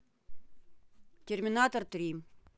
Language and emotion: Russian, neutral